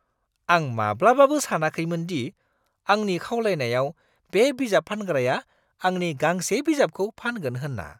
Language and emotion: Bodo, surprised